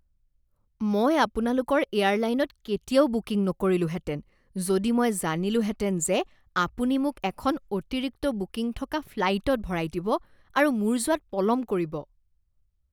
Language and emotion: Assamese, disgusted